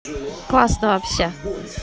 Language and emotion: Russian, neutral